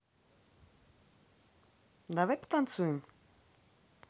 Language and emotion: Russian, neutral